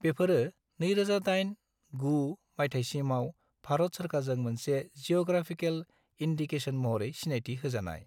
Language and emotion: Bodo, neutral